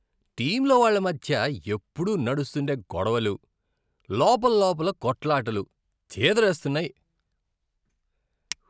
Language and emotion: Telugu, disgusted